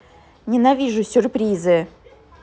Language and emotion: Russian, angry